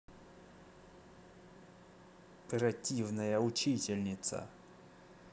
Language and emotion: Russian, angry